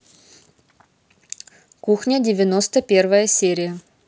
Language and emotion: Russian, positive